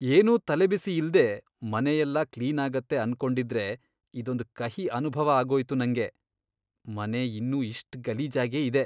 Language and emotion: Kannada, disgusted